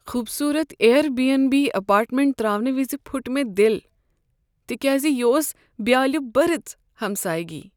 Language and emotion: Kashmiri, sad